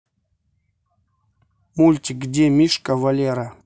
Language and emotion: Russian, neutral